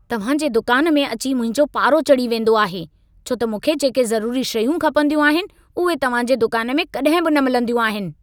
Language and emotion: Sindhi, angry